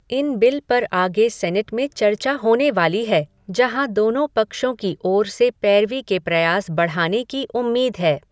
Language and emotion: Hindi, neutral